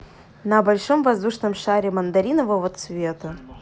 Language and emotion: Russian, positive